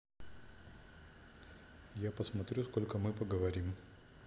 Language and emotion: Russian, neutral